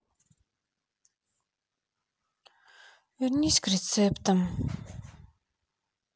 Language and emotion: Russian, sad